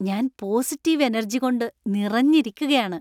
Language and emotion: Malayalam, happy